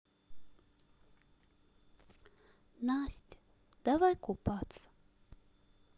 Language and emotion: Russian, sad